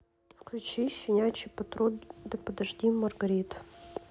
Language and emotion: Russian, sad